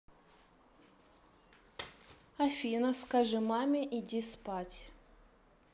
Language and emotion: Russian, neutral